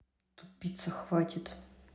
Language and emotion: Russian, neutral